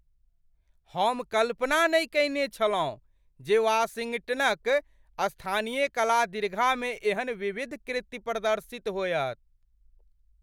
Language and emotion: Maithili, surprised